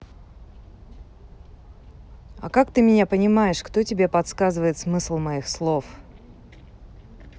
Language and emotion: Russian, neutral